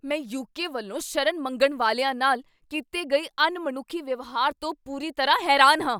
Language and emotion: Punjabi, angry